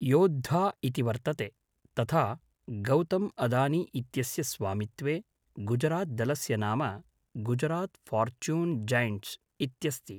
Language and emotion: Sanskrit, neutral